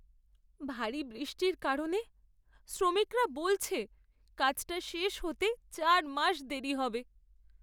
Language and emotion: Bengali, sad